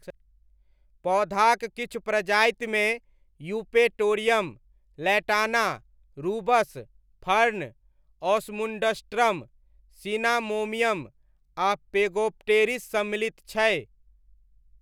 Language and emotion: Maithili, neutral